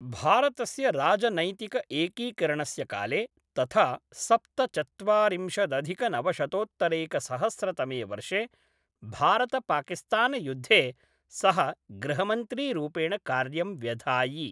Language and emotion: Sanskrit, neutral